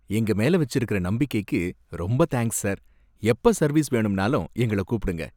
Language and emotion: Tamil, happy